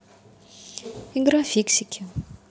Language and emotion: Russian, neutral